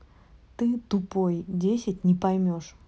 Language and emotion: Russian, neutral